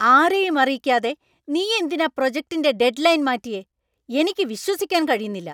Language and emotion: Malayalam, angry